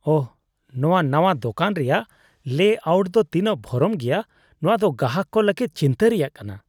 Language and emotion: Santali, disgusted